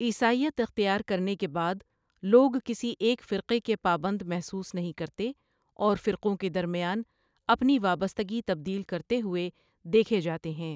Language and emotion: Urdu, neutral